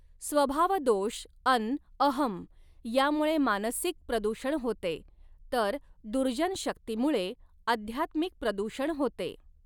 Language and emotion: Marathi, neutral